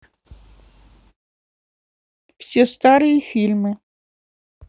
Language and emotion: Russian, neutral